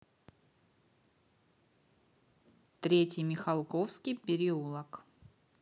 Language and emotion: Russian, neutral